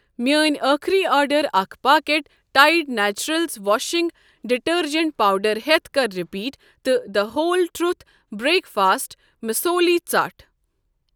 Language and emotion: Kashmiri, neutral